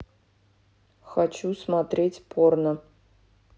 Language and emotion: Russian, neutral